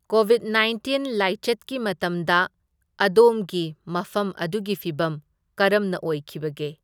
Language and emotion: Manipuri, neutral